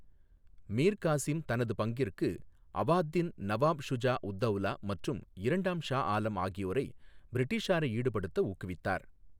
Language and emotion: Tamil, neutral